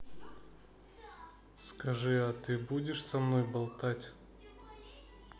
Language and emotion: Russian, neutral